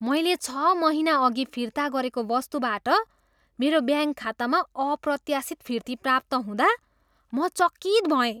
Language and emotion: Nepali, surprised